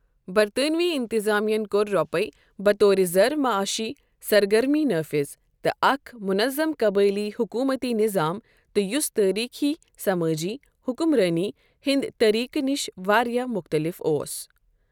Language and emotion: Kashmiri, neutral